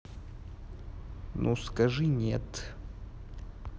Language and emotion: Russian, neutral